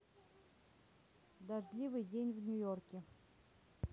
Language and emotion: Russian, neutral